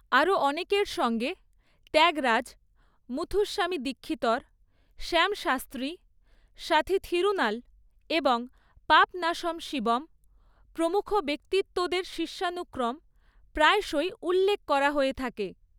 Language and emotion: Bengali, neutral